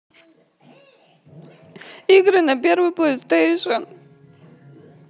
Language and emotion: Russian, sad